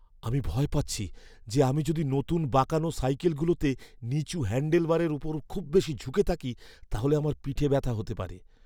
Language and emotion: Bengali, fearful